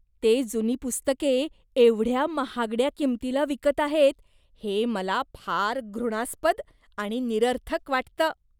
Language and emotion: Marathi, disgusted